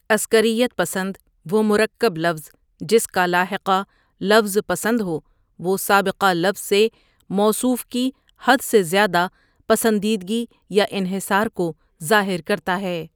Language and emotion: Urdu, neutral